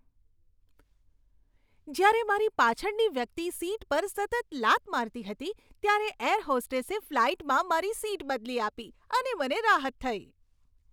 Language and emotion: Gujarati, happy